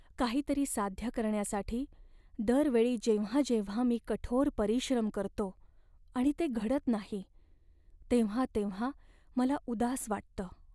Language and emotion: Marathi, sad